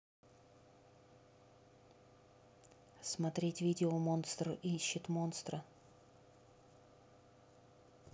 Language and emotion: Russian, neutral